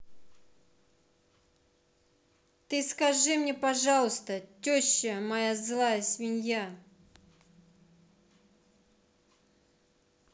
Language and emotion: Russian, angry